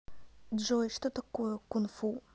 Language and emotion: Russian, neutral